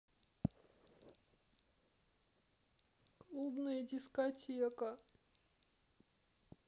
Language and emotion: Russian, sad